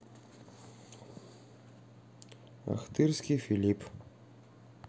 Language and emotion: Russian, neutral